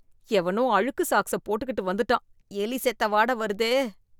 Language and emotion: Tamil, disgusted